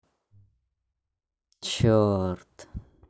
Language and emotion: Russian, angry